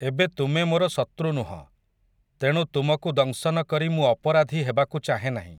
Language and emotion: Odia, neutral